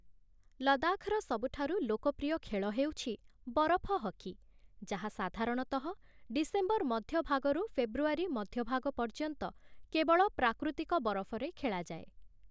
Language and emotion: Odia, neutral